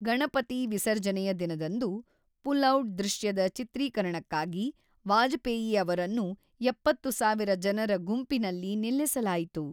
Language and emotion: Kannada, neutral